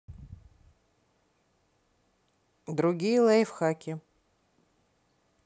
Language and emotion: Russian, neutral